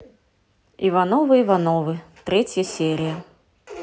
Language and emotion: Russian, neutral